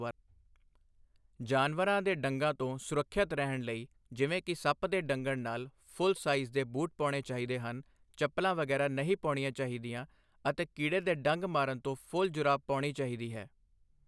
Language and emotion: Punjabi, neutral